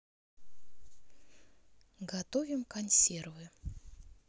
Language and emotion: Russian, neutral